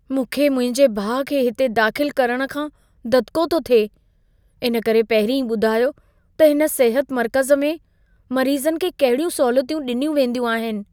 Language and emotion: Sindhi, fearful